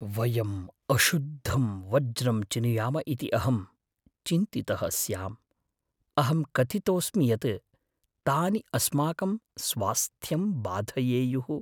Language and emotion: Sanskrit, fearful